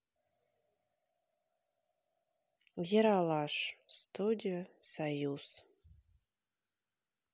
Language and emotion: Russian, neutral